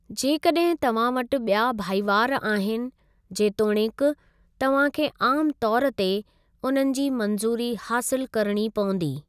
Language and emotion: Sindhi, neutral